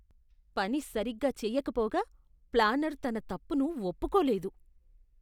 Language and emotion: Telugu, disgusted